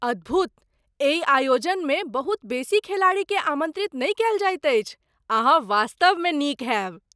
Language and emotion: Maithili, surprised